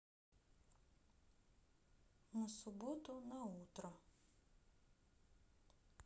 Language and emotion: Russian, neutral